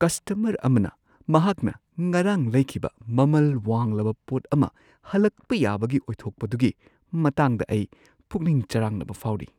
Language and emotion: Manipuri, fearful